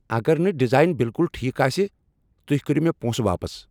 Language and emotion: Kashmiri, angry